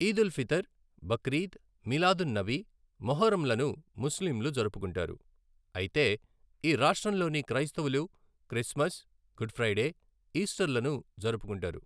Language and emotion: Telugu, neutral